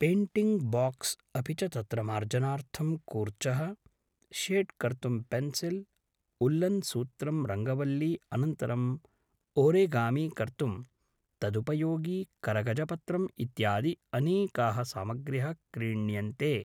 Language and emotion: Sanskrit, neutral